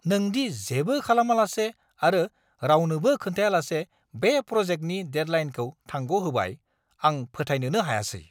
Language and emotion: Bodo, angry